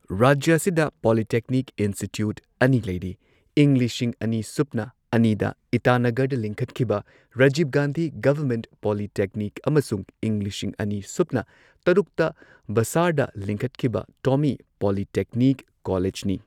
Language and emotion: Manipuri, neutral